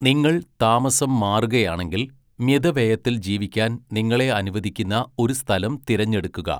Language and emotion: Malayalam, neutral